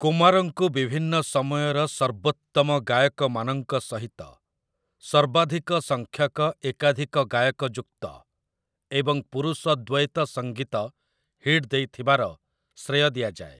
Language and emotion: Odia, neutral